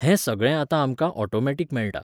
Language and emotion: Goan Konkani, neutral